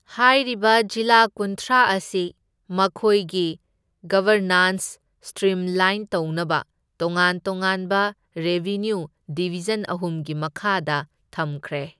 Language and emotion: Manipuri, neutral